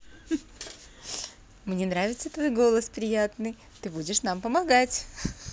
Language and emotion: Russian, positive